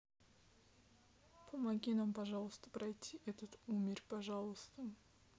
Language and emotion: Russian, sad